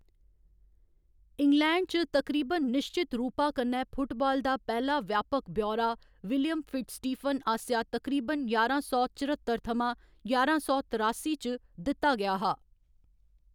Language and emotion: Dogri, neutral